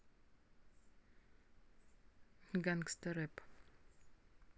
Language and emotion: Russian, neutral